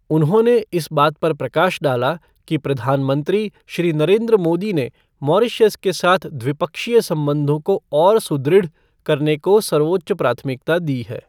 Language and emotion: Hindi, neutral